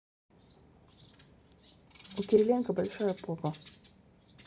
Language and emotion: Russian, neutral